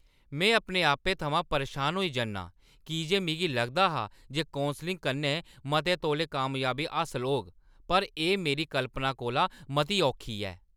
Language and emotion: Dogri, angry